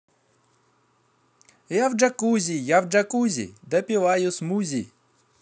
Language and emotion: Russian, positive